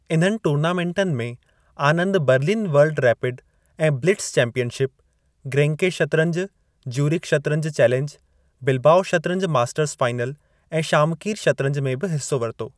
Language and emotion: Sindhi, neutral